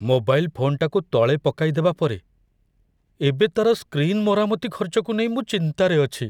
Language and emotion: Odia, fearful